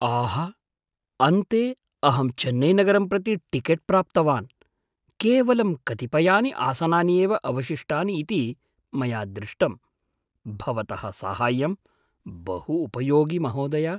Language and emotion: Sanskrit, surprised